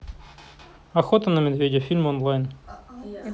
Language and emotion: Russian, neutral